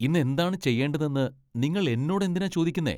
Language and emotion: Malayalam, disgusted